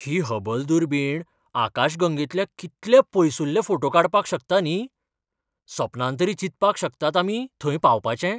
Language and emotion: Goan Konkani, surprised